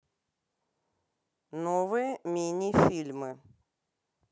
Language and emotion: Russian, neutral